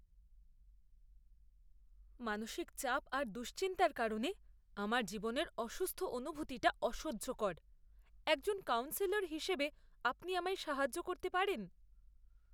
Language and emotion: Bengali, disgusted